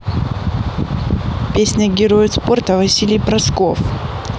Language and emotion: Russian, neutral